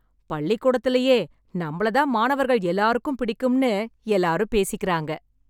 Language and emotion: Tamil, happy